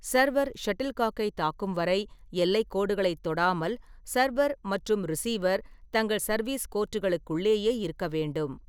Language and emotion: Tamil, neutral